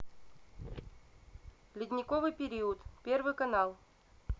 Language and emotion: Russian, neutral